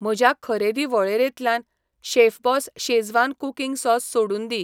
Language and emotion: Goan Konkani, neutral